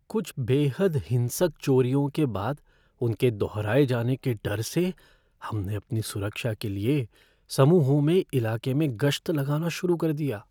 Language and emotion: Hindi, fearful